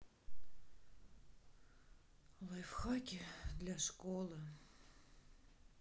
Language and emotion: Russian, sad